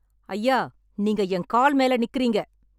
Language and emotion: Tamil, angry